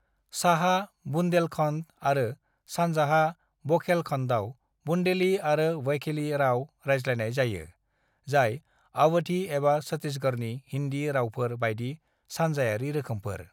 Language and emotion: Bodo, neutral